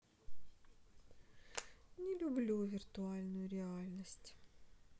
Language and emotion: Russian, sad